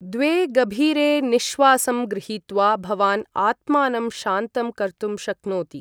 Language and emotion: Sanskrit, neutral